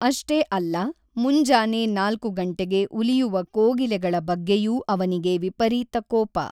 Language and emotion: Kannada, neutral